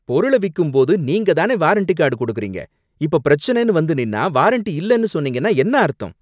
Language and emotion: Tamil, angry